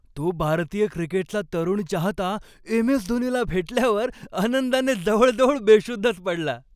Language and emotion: Marathi, happy